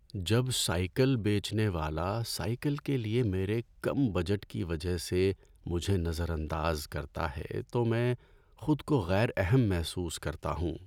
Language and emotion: Urdu, sad